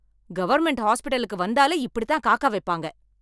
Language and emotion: Tamil, angry